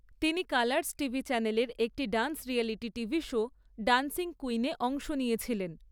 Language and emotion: Bengali, neutral